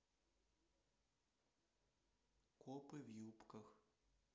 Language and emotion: Russian, neutral